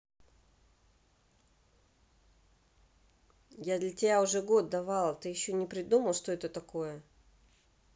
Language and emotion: Russian, angry